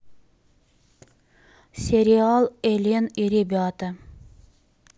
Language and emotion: Russian, neutral